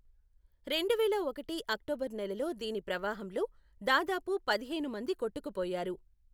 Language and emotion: Telugu, neutral